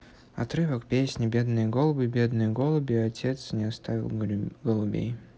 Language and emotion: Russian, neutral